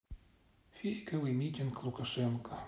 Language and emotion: Russian, neutral